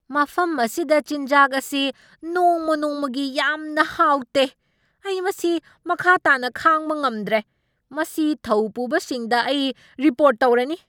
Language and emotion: Manipuri, angry